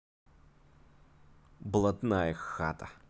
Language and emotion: Russian, positive